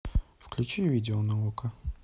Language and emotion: Russian, neutral